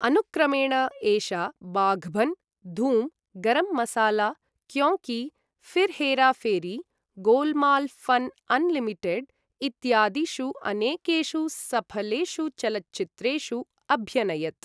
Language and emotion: Sanskrit, neutral